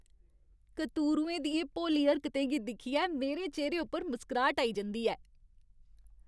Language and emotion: Dogri, happy